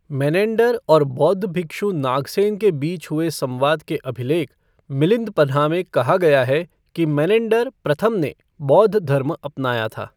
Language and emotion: Hindi, neutral